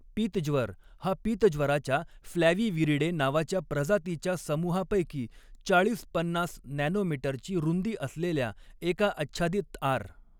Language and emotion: Marathi, neutral